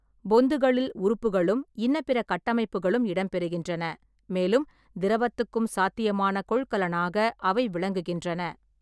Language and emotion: Tamil, neutral